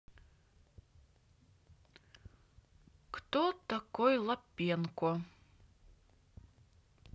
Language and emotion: Russian, neutral